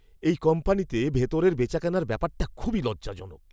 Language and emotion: Bengali, disgusted